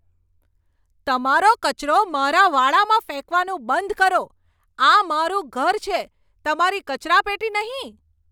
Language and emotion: Gujarati, angry